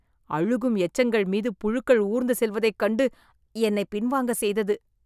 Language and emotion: Tamil, disgusted